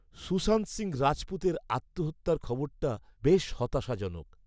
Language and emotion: Bengali, sad